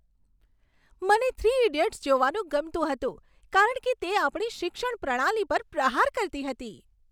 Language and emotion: Gujarati, happy